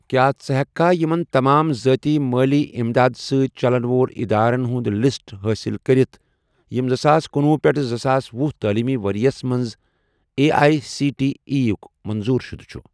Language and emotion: Kashmiri, neutral